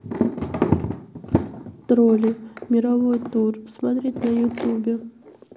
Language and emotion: Russian, sad